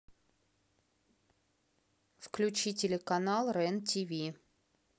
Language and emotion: Russian, neutral